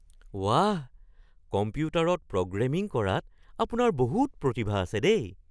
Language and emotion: Assamese, surprised